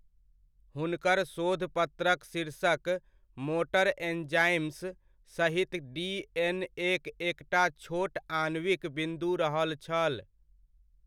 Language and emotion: Maithili, neutral